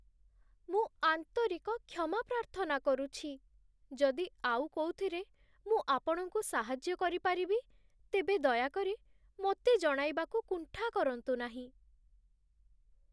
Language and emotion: Odia, sad